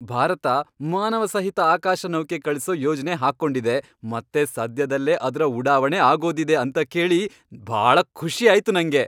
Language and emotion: Kannada, happy